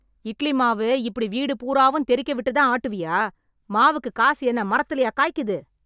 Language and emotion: Tamil, angry